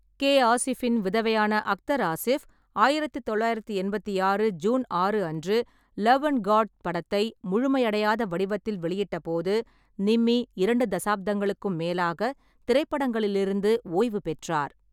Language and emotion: Tamil, neutral